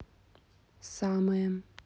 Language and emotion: Russian, neutral